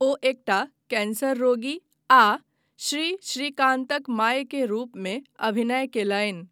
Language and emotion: Maithili, neutral